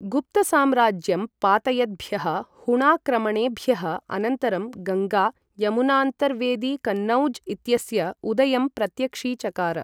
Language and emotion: Sanskrit, neutral